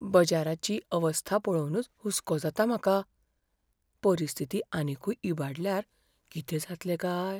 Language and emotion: Goan Konkani, fearful